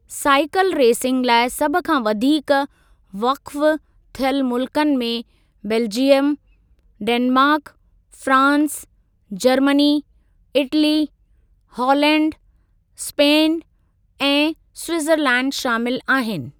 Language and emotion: Sindhi, neutral